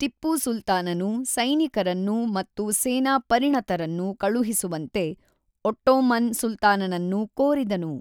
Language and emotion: Kannada, neutral